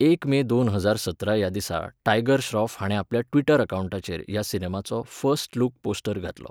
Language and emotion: Goan Konkani, neutral